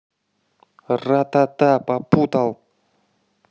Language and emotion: Russian, angry